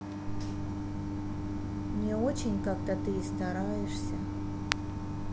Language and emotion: Russian, sad